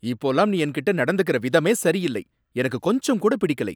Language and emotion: Tamil, angry